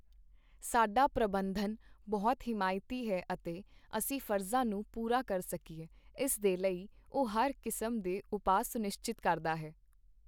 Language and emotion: Punjabi, neutral